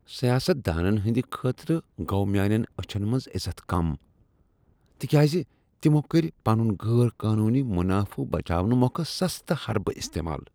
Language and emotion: Kashmiri, disgusted